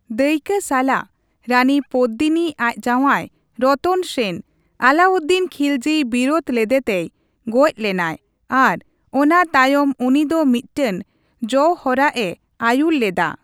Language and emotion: Santali, neutral